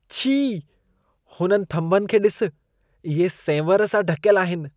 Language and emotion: Sindhi, disgusted